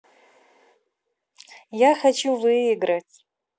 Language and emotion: Russian, positive